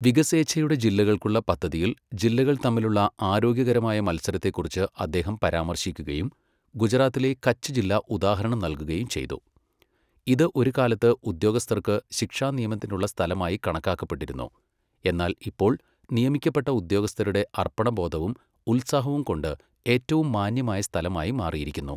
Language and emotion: Malayalam, neutral